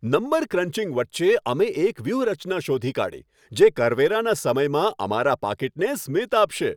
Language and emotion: Gujarati, happy